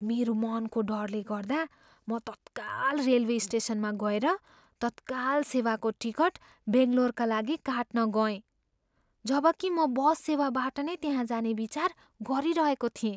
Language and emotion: Nepali, fearful